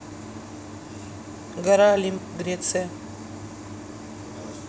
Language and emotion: Russian, neutral